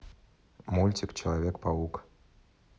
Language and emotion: Russian, neutral